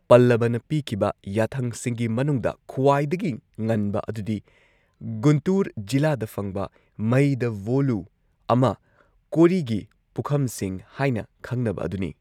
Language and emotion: Manipuri, neutral